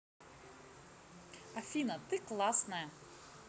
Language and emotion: Russian, positive